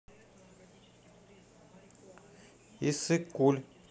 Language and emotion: Russian, neutral